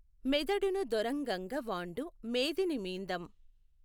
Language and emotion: Telugu, neutral